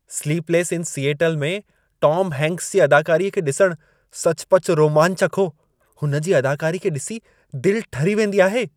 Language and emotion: Sindhi, happy